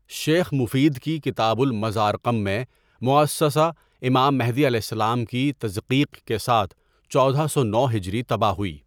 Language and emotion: Urdu, neutral